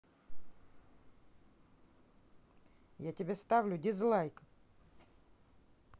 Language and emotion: Russian, angry